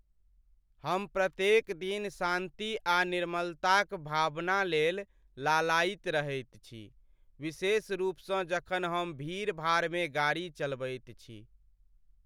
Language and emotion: Maithili, sad